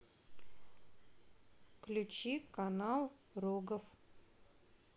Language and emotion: Russian, neutral